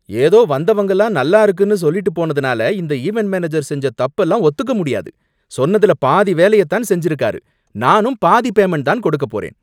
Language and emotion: Tamil, angry